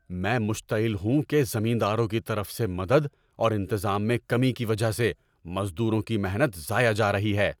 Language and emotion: Urdu, angry